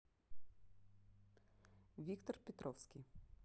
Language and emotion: Russian, neutral